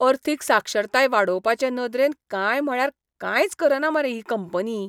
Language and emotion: Goan Konkani, disgusted